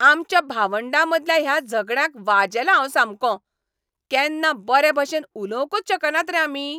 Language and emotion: Goan Konkani, angry